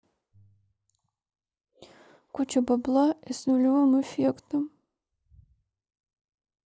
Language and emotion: Russian, sad